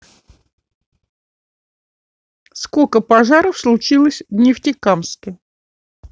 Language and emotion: Russian, neutral